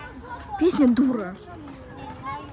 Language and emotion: Russian, angry